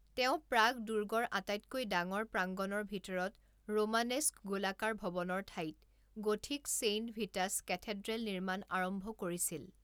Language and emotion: Assamese, neutral